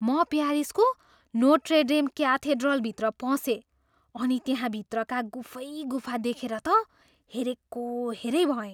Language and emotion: Nepali, surprised